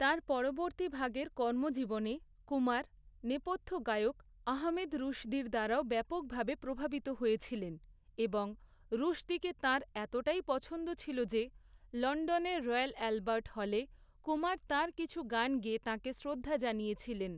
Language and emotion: Bengali, neutral